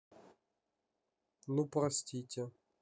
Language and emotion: Russian, neutral